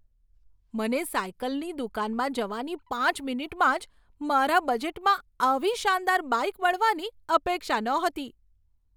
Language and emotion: Gujarati, surprised